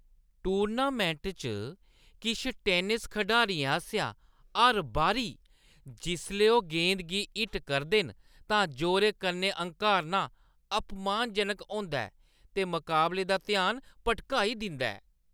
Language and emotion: Dogri, disgusted